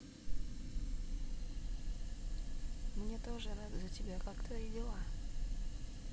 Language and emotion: Russian, neutral